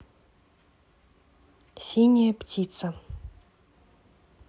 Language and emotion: Russian, neutral